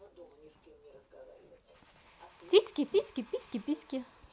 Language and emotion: Russian, positive